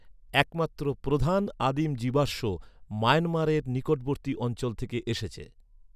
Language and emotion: Bengali, neutral